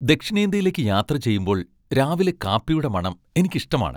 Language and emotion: Malayalam, happy